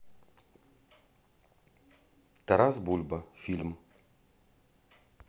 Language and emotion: Russian, neutral